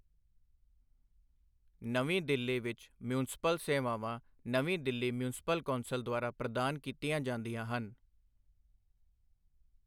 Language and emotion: Punjabi, neutral